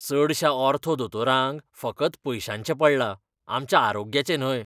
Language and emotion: Goan Konkani, disgusted